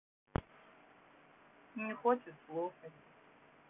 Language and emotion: Russian, neutral